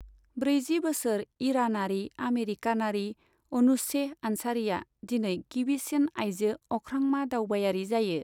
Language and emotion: Bodo, neutral